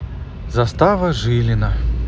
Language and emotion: Russian, neutral